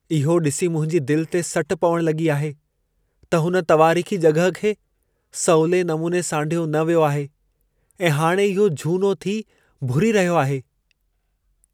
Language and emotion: Sindhi, sad